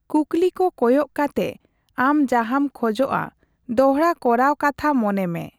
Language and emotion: Santali, neutral